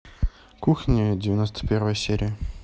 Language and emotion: Russian, neutral